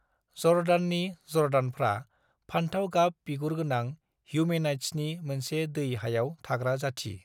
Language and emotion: Bodo, neutral